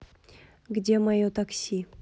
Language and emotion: Russian, neutral